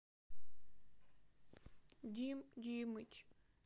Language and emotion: Russian, sad